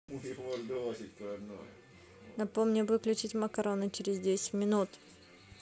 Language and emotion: Russian, neutral